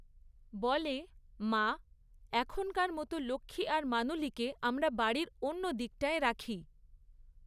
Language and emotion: Bengali, neutral